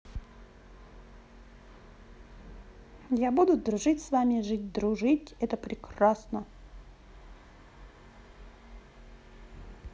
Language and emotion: Russian, positive